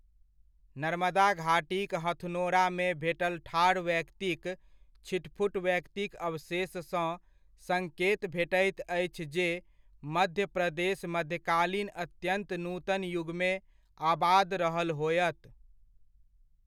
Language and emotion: Maithili, neutral